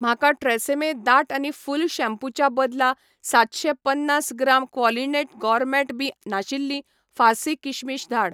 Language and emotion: Goan Konkani, neutral